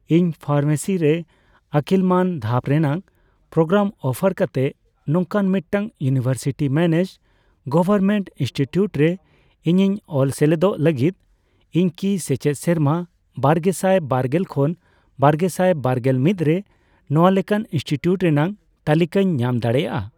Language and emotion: Santali, neutral